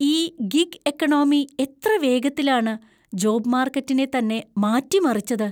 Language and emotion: Malayalam, surprised